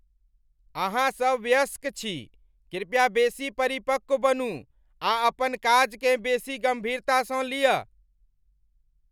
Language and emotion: Maithili, angry